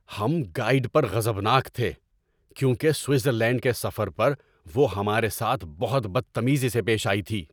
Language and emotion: Urdu, angry